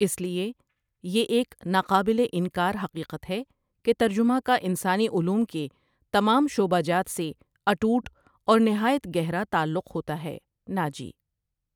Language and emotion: Urdu, neutral